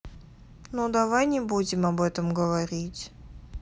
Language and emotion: Russian, sad